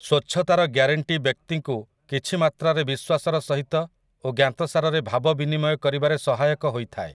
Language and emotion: Odia, neutral